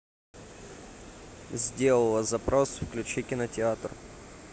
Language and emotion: Russian, neutral